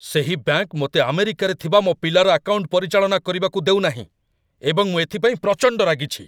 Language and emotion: Odia, angry